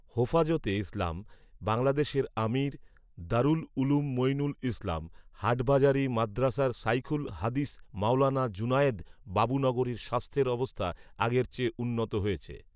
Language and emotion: Bengali, neutral